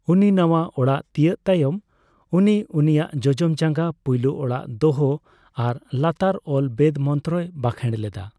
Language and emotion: Santali, neutral